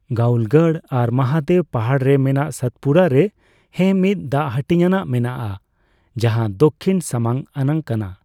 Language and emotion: Santali, neutral